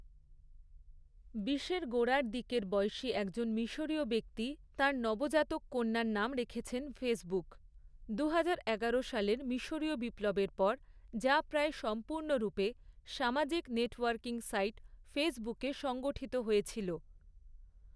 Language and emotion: Bengali, neutral